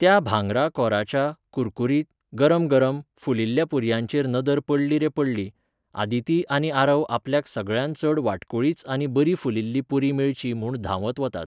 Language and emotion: Goan Konkani, neutral